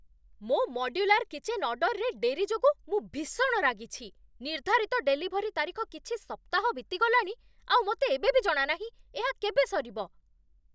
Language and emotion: Odia, angry